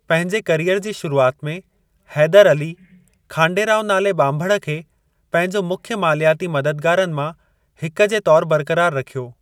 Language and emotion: Sindhi, neutral